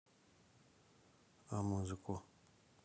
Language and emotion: Russian, neutral